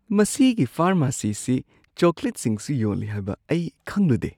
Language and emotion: Manipuri, surprised